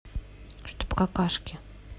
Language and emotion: Russian, neutral